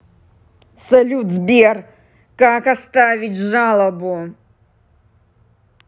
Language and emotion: Russian, angry